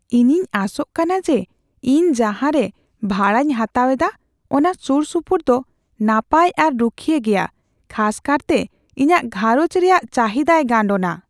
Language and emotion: Santali, fearful